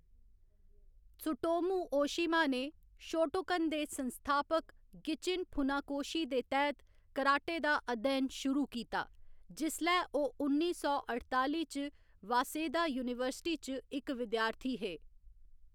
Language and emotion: Dogri, neutral